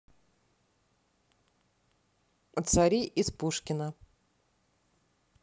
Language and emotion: Russian, neutral